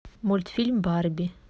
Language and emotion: Russian, neutral